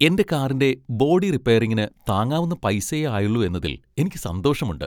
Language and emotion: Malayalam, happy